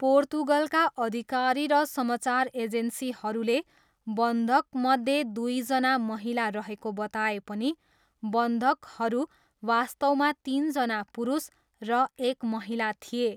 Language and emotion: Nepali, neutral